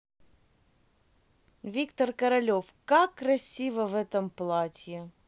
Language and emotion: Russian, positive